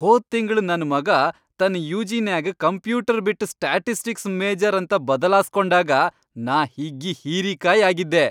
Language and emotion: Kannada, happy